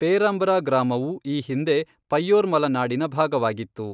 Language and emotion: Kannada, neutral